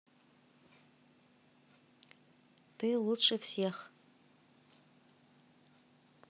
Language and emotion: Russian, neutral